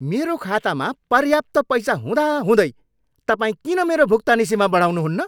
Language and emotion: Nepali, angry